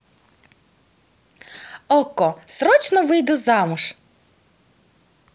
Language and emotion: Russian, positive